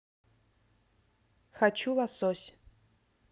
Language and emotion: Russian, neutral